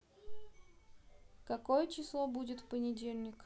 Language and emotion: Russian, neutral